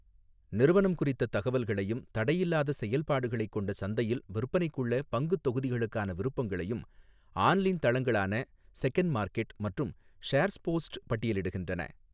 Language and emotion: Tamil, neutral